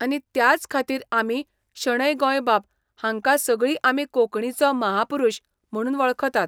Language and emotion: Goan Konkani, neutral